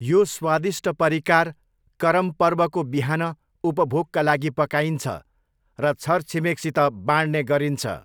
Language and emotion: Nepali, neutral